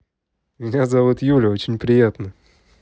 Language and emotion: Russian, positive